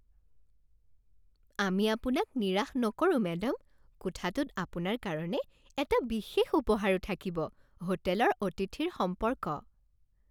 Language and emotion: Assamese, happy